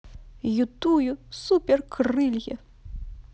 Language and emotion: Russian, positive